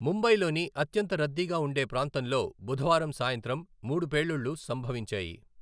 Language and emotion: Telugu, neutral